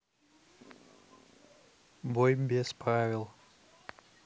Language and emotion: Russian, neutral